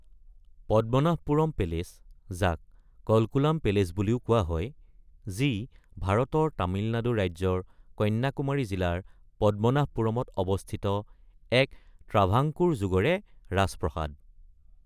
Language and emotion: Assamese, neutral